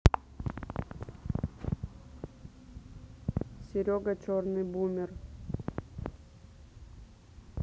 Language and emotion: Russian, neutral